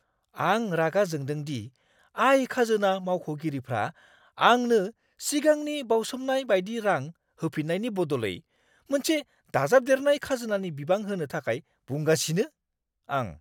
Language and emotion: Bodo, angry